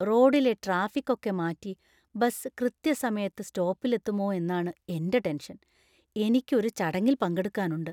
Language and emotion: Malayalam, fearful